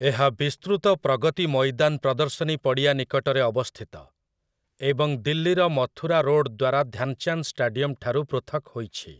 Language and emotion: Odia, neutral